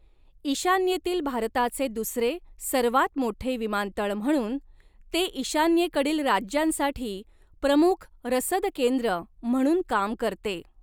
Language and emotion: Marathi, neutral